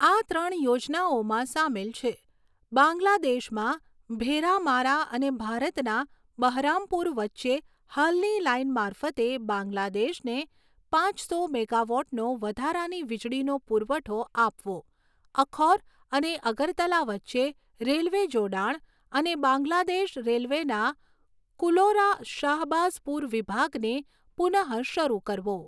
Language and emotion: Gujarati, neutral